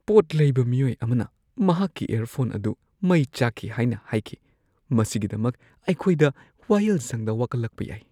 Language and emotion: Manipuri, fearful